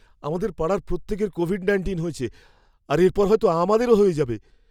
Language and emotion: Bengali, fearful